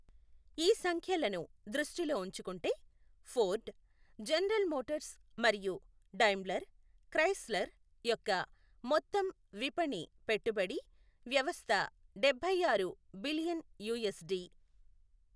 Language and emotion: Telugu, neutral